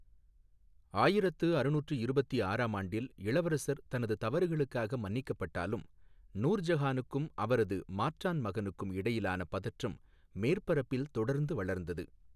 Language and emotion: Tamil, neutral